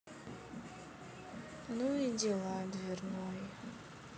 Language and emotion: Russian, sad